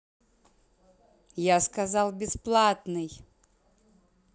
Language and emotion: Russian, angry